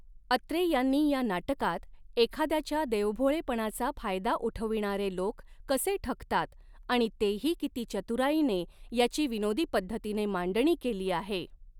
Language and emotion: Marathi, neutral